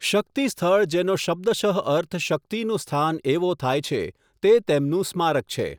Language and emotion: Gujarati, neutral